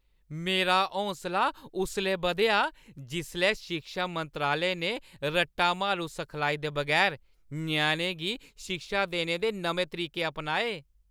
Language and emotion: Dogri, happy